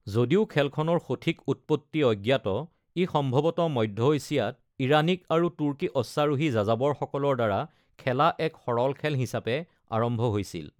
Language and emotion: Assamese, neutral